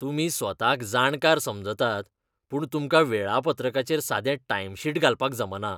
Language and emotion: Goan Konkani, disgusted